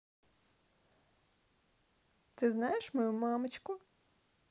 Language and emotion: Russian, neutral